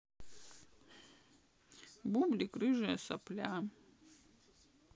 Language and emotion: Russian, sad